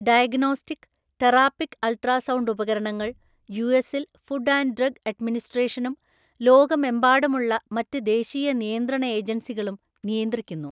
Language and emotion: Malayalam, neutral